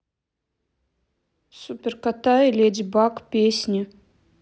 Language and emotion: Russian, neutral